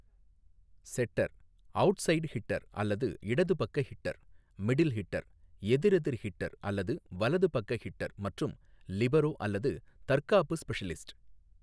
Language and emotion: Tamil, neutral